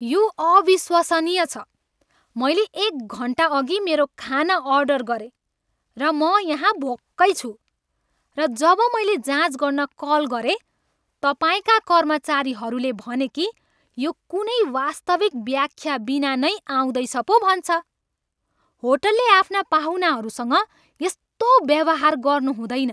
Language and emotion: Nepali, angry